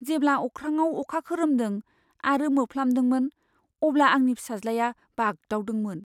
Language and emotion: Bodo, fearful